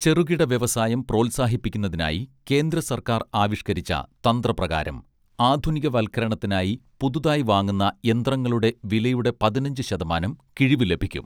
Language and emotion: Malayalam, neutral